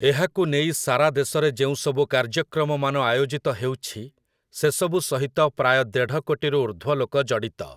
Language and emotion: Odia, neutral